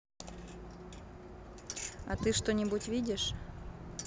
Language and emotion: Russian, neutral